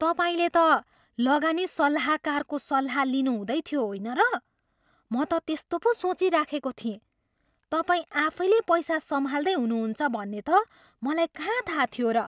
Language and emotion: Nepali, surprised